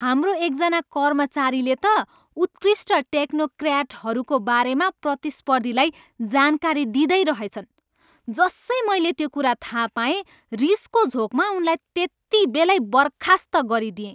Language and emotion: Nepali, angry